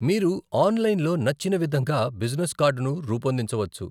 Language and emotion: Telugu, neutral